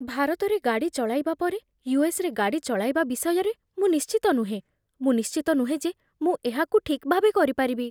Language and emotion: Odia, fearful